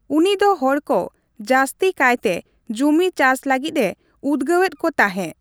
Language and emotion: Santali, neutral